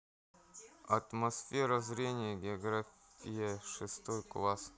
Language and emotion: Russian, neutral